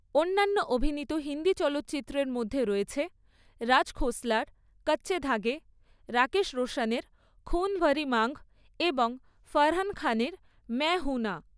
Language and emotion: Bengali, neutral